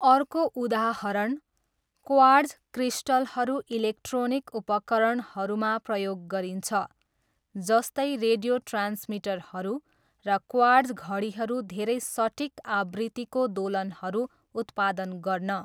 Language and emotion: Nepali, neutral